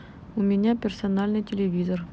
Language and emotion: Russian, neutral